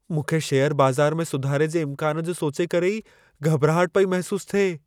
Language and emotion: Sindhi, fearful